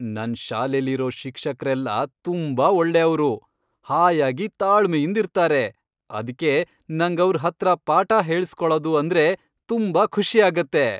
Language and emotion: Kannada, happy